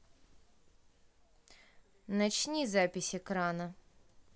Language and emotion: Russian, neutral